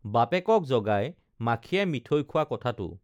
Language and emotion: Assamese, neutral